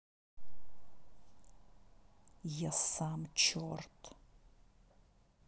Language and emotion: Russian, angry